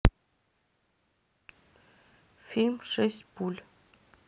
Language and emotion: Russian, neutral